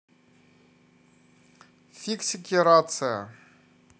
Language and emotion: Russian, neutral